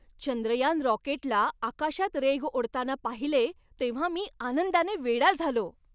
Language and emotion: Marathi, happy